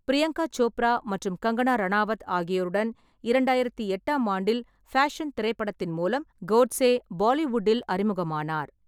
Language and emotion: Tamil, neutral